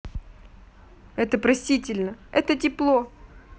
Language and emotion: Russian, neutral